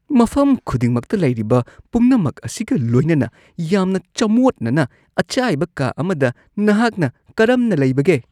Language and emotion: Manipuri, disgusted